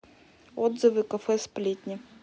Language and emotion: Russian, neutral